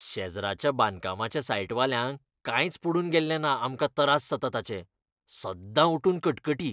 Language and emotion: Goan Konkani, disgusted